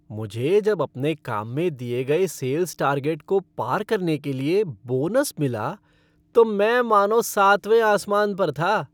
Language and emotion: Hindi, happy